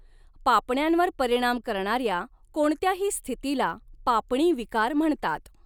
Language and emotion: Marathi, neutral